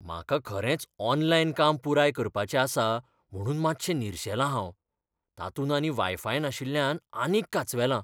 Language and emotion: Goan Konkani, fearful